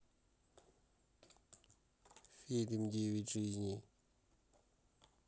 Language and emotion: Russian, neutral